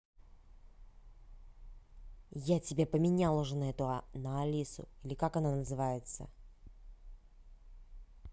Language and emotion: Russian, angry